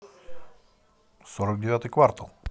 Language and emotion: Russian, positive